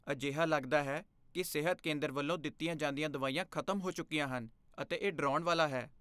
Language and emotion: Punjabi, fearful